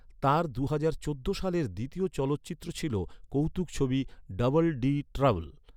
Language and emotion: Bengali, neutral